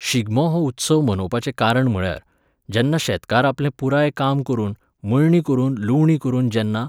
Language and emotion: Goan Konkani, neutral